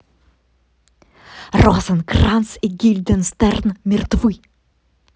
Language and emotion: Russian, positive